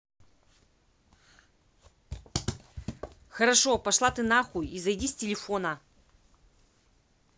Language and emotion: Russian, angry